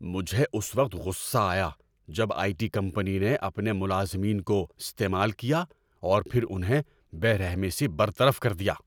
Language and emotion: Urdu, angry